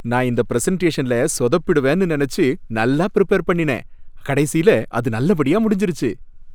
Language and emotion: Tamil, happy